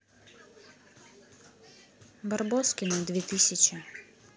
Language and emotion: Russian, neutral